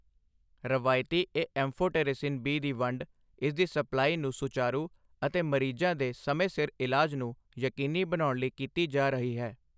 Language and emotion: Punjabi, neutral